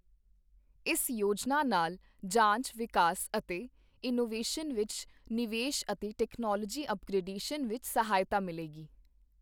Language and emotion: Punjabi, neutral